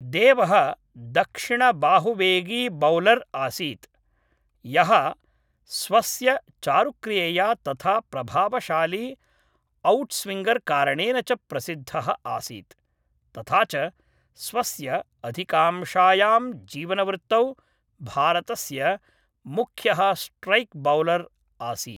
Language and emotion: Sanskrit, neutral